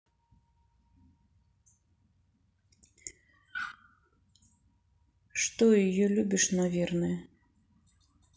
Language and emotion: Russian, sad